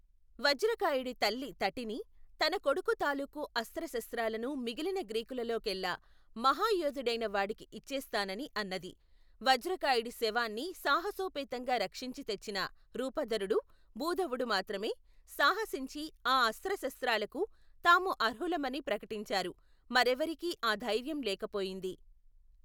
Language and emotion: Telugu, neutral